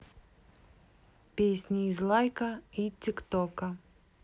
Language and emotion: Russian, neutral